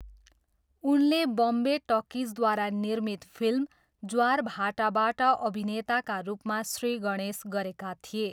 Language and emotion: Nepali, neutral